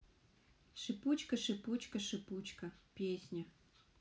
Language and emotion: Russian, neutral